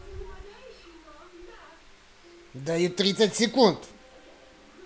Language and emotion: Russian, angry